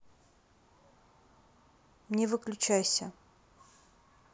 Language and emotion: Russian, neutral